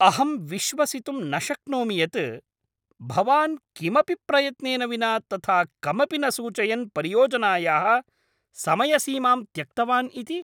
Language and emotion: Sanskrit, angry